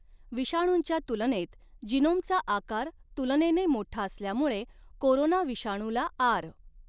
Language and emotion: Marathi, neutral